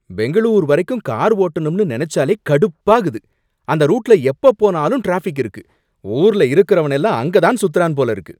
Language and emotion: Tamil, angry